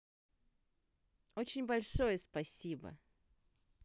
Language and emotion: Russian, positive